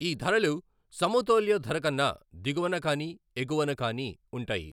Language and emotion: Telugu, neutral